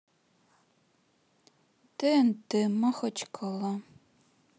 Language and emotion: Russian, sad